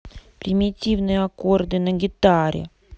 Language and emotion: Russian, neutral